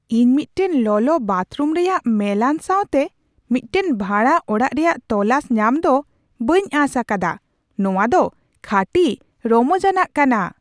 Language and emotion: Santali, surprised